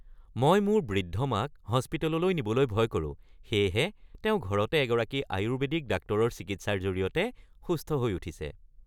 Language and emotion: Assamese, happy